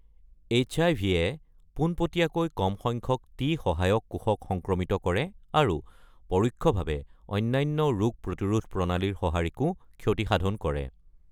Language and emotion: Assamese, neutral